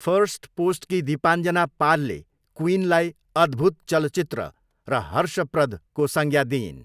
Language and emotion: Nepali, neutral